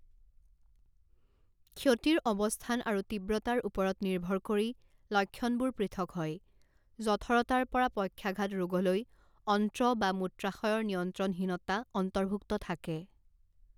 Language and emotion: Assamese, neutral